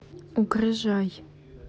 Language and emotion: Russian, neutral